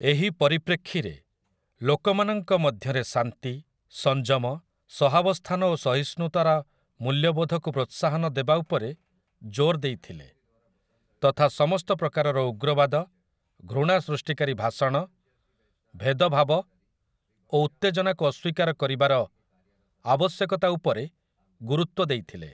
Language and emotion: Odia, neutral